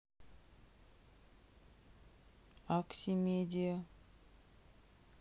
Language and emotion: Russian, neutral